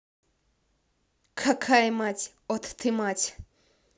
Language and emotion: Russian, angry